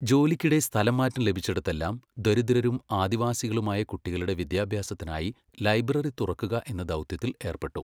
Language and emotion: Malayalam, neutral